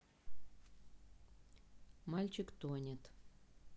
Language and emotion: Russian, neutral